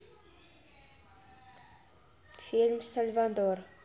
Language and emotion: Russian, neutral